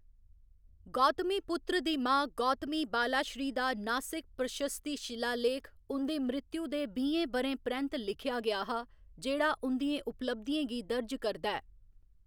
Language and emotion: Dogri, neutral